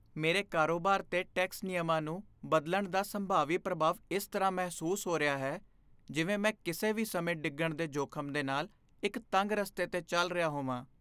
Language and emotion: Punjabi, fearful